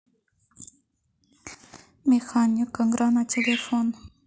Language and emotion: Russian, neutral